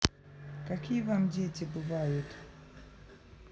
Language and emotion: Russian, neutral